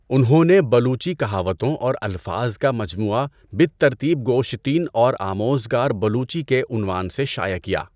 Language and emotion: Urdu, neutral